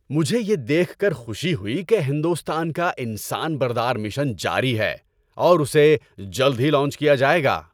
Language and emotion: Urdu, happy